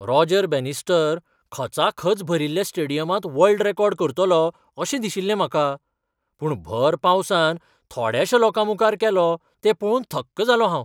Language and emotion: Goan Konkani, surprised